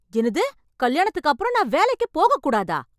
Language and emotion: Tamil, angry